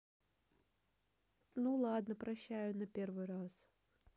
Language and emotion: Russian, neutral